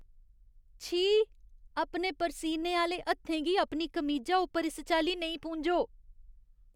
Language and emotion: Dogri, disgusted